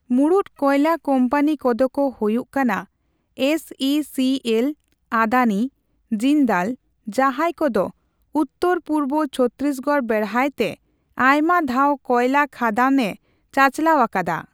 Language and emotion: Santali, neutral